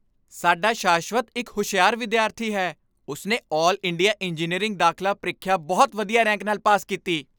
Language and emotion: Punjabi, happy